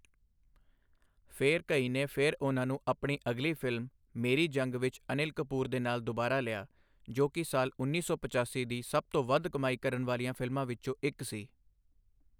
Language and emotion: Punjabi, neutral